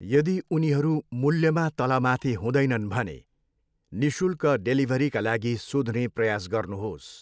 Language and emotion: Nepali, neutral